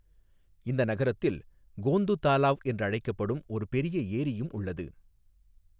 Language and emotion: Tamil, neutral